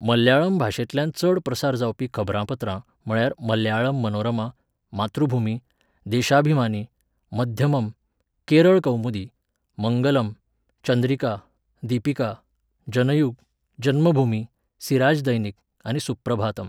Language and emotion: Goan Konkani, neutral